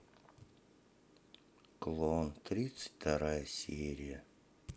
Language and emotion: Russian, sad